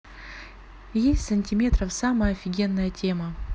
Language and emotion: Russian, neutral